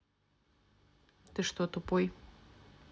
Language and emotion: Russian, neutral